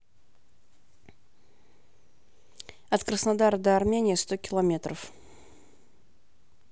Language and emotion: Russian, neutral